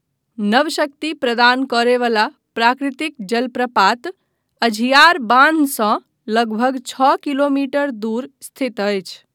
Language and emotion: Maithili, neutral